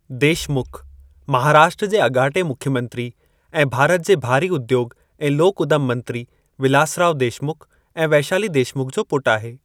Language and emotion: Sindhi, neutral